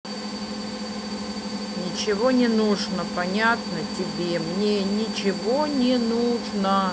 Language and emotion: Russian, angry